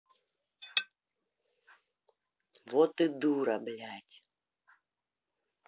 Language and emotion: Russian, angry